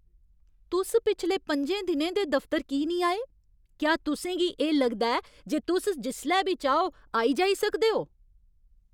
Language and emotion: Dogri, angry